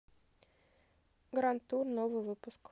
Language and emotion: Russian, neutral